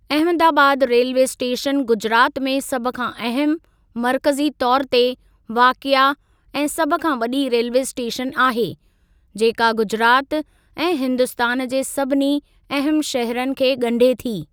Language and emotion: Sindhi, neutral